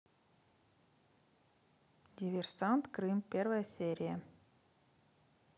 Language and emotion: Russian, neutral